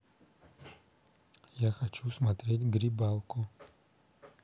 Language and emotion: Russian, neutral